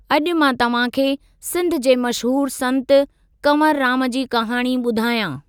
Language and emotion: Sindhi, neutral